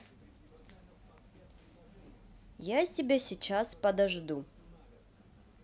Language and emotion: Russian, neutral